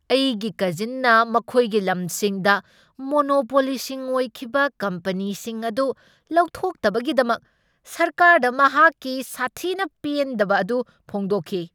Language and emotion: Manipuri, angry